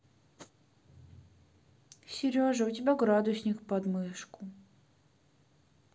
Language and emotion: Russian, sad